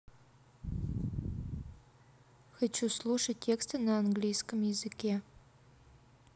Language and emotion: Russian, neutral